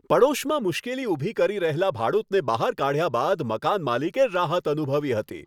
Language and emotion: Gujarati, happy